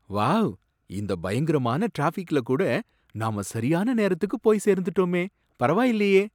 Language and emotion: Tamil, surprised